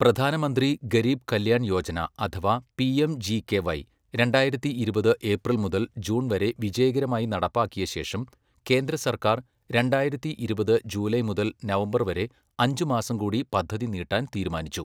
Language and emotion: Malayalam, neutral